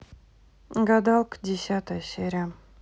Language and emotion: Russian, neutral